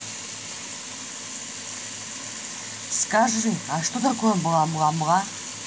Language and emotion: Russian, neutral